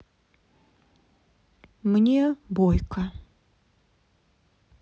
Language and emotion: Russian, sad